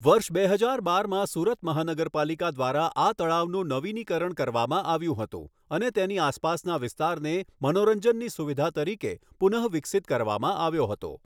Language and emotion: Gujarati, neutral